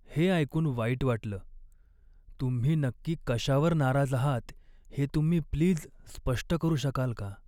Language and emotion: Marathi, sad